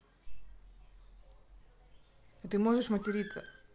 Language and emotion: Russian, neutral